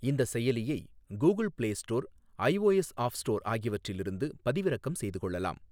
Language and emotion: Tamil, neutral